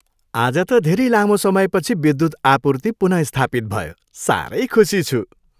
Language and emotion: Nepali, happy